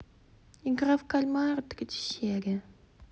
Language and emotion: Russian, neutral